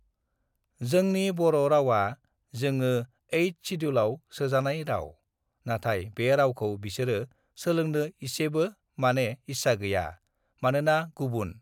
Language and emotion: Bodo, neutral